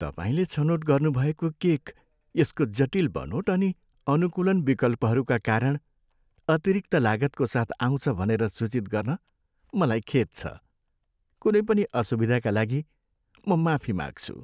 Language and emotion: Nepali, sad